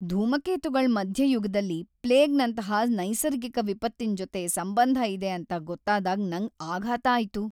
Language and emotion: Kannada, sad